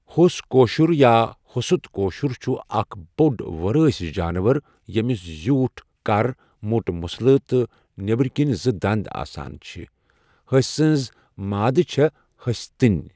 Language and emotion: Kashmiri, neutral